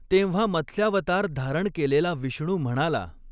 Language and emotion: Marathi, neutral